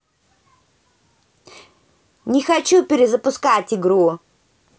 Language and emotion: Russian, angry